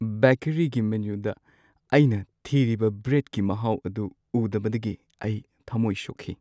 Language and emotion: Manipuri, sad